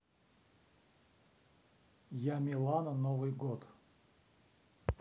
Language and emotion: Russian, neutral